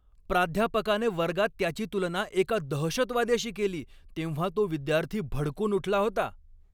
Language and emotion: Marathi, angry